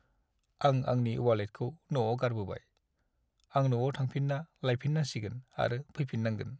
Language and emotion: Bodo, sad